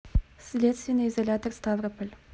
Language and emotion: Russian, neutral